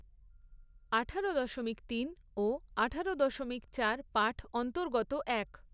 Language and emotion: Bengali, neutral